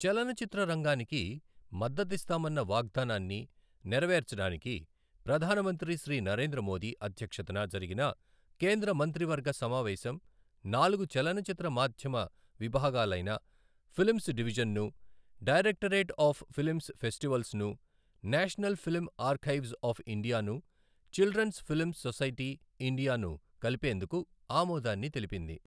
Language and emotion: Telugu, neutral